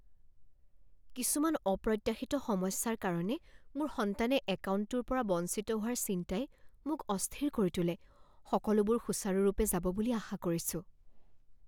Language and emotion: Assamese, fearful